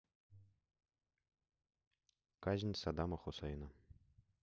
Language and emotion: Russian, neutral